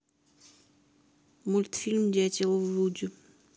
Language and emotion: Russian, neutral